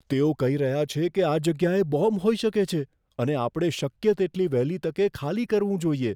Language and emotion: Gujarati, fearful